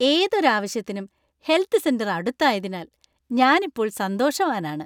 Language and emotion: Malayalam, happy